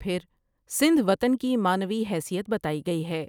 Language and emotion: Urdu, neutral